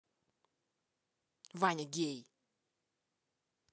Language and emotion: Russian, angry